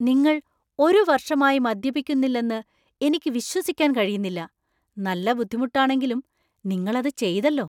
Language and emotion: Malayalam, surprised